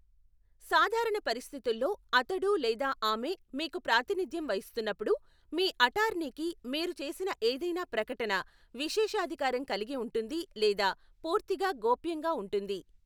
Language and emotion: Telugu, neutral